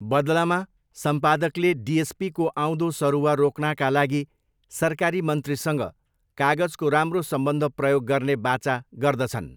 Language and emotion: Nepali, neutral